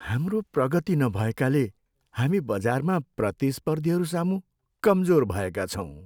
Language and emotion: Nepali, sad